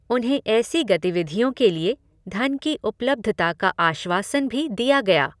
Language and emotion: Hindi, neutral